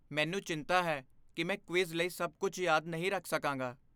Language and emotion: Punjabi, fearful